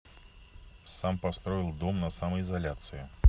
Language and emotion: Russian, neutral